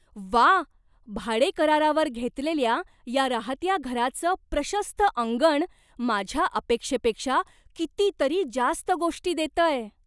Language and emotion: Marathi, surprised